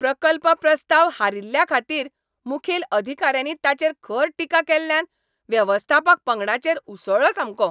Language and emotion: Goan Konkani, angry